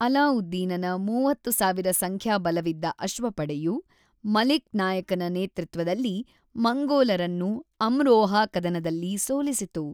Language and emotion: Kannada, neutral